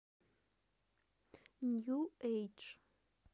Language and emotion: Russian, neutral